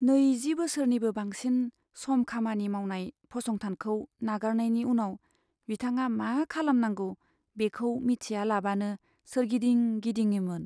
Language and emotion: Bodo, sad